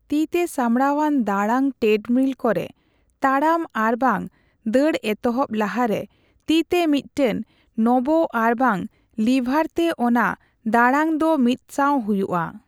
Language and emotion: Santali, neutral